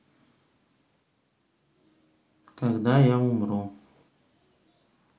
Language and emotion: Russian, sad